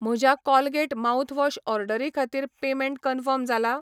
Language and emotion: Goan Konkani, neutral